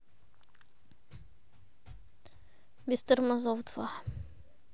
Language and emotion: Russian, neutral